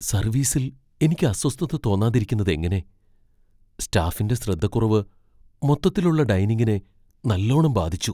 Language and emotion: Malayalam, fearful